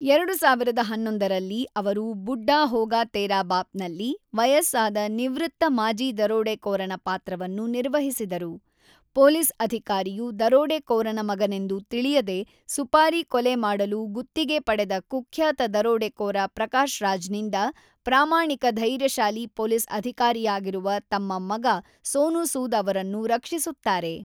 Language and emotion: Kannada, neutral